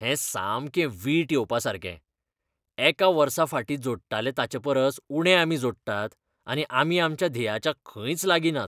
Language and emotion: Goan Konkani, disgusted